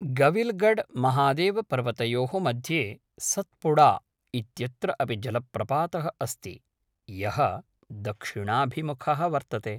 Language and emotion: Sanskrit, neutral